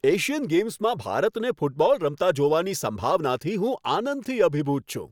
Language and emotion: Gujarati, happy